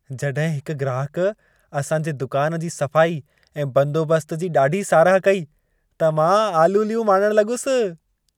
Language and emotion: Sindhi, happy